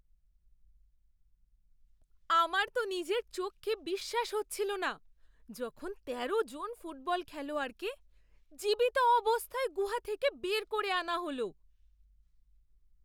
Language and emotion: Bengali, surprised